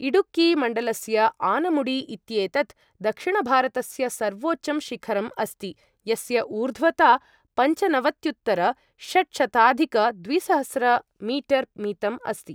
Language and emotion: Sanskrit, neutral